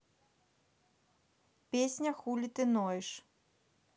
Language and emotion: Russian, neutral